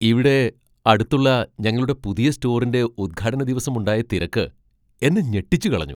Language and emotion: Malayalam, surprised